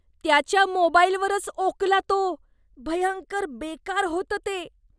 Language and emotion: Marathi, disgusted